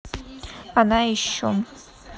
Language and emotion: Russian, neutral